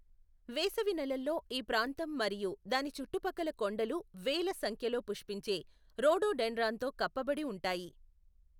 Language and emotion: Telugu, neutral